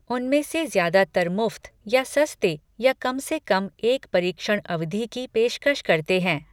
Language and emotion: Hindi, neutral